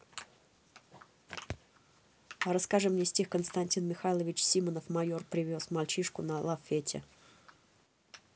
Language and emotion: Russian, neutral